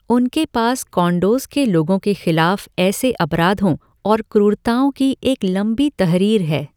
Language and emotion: Hindi, neutral